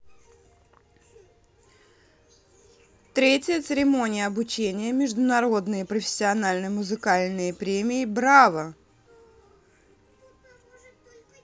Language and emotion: Russian, neutral